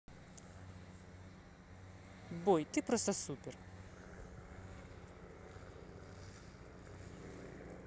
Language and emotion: Russian, positive